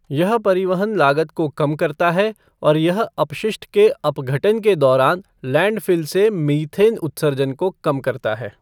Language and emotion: Hindi, neutral